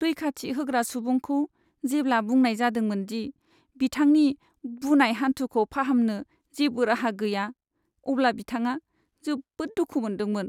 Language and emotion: Bodo, sad